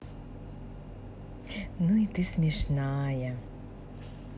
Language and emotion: Russian, positive